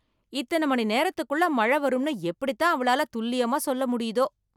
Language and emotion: Tamil, surprised